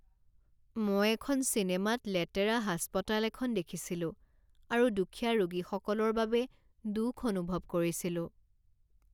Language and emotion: Assamese, sad